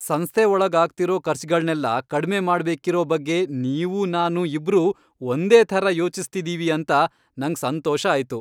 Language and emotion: Kannada, happy